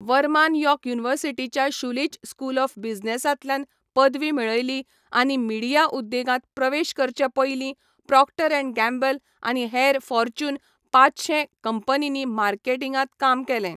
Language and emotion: Goan Konkani, neutral